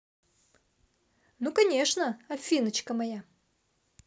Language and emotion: Russian, positive